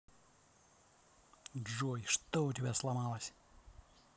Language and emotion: Russian, angry